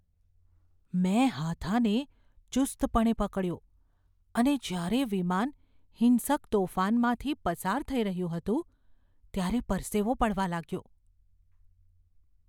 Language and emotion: Gujarati, fearful